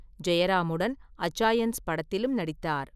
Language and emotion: Tamil, neutral